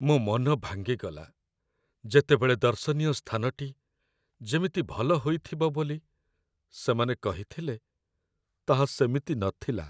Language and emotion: Odia, sad